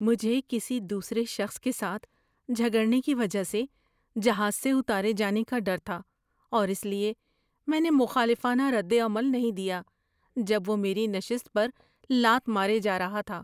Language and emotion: Urdu, fearful